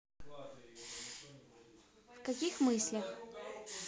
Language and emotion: Russian, neutral